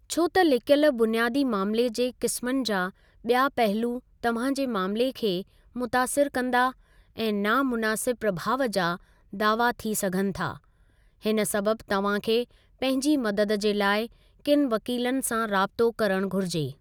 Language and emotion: Sindhi, neutral